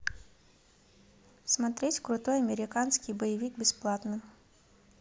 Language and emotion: Russian, neutral